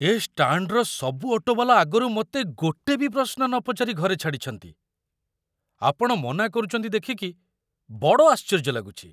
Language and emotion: Odia, surprised